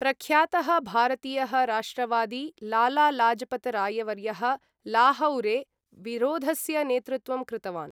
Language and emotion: Sanskrit, neutral